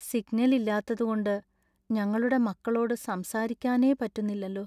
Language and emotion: Malayalam, sad